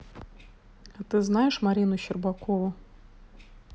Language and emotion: Russian, neutral